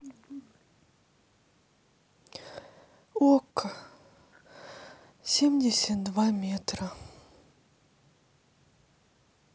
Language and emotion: Russian, sad